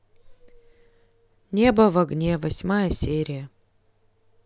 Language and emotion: Russian, neutral